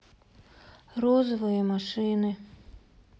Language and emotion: Russian, sad